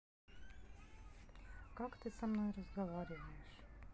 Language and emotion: Russian, neutral